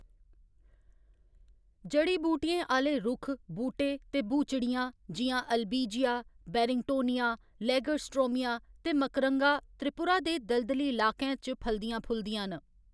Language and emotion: Dogri, neutral